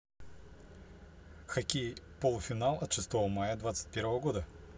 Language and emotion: Russian, neutral